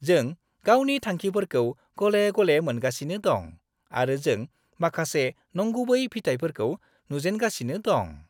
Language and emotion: Bodo, happy